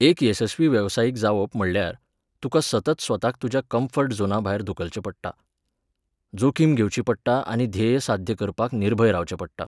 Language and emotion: Goan Konkani, neutral